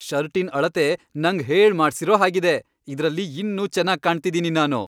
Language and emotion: Kannada, happy